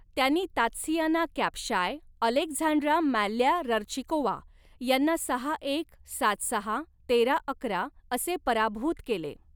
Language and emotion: Marathi, neutral